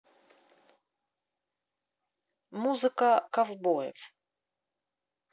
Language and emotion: Russian, neutral